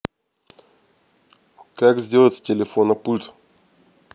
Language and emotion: Russian, neutral